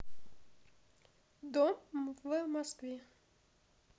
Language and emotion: Russian, neutral